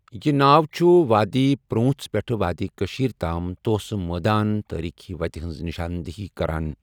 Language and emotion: Kashmiri, neutral